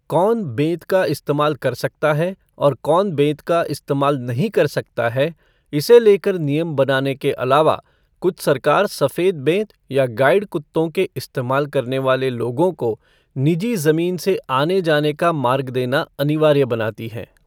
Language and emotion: Hindi, neutral